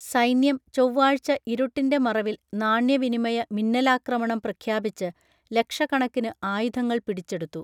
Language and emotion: Malayalam, neutral